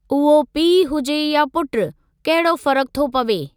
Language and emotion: Sindhi, neutral